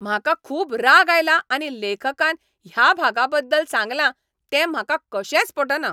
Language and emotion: Goan Konkani, angry